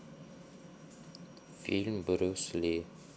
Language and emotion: Russian, neutral